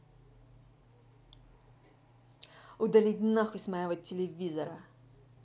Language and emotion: Russian, angry